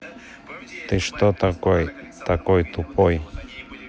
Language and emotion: Russian, neutral